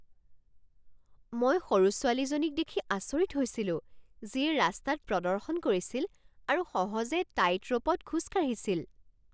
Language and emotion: Assamese, surprised